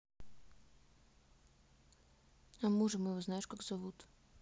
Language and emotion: Russian, neutral